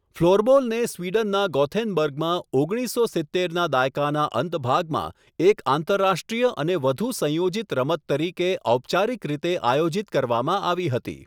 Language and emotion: Gujarati, neutral